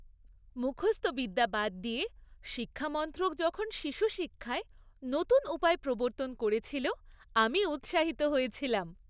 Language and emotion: Bengali, happy